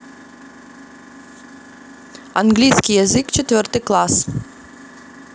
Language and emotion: Russian, neutral